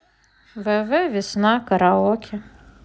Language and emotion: Russian, sad